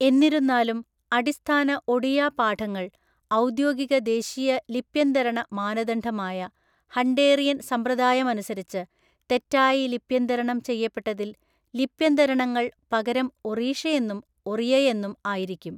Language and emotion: Malayalam, neutral